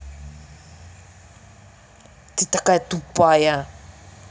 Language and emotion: Russian, angry